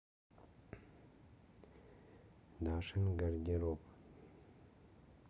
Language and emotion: Russian, neutral